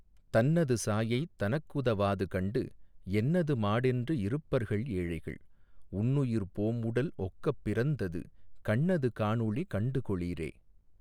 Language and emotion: Tamil, neutral